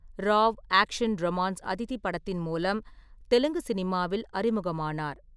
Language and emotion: Tamil, neutral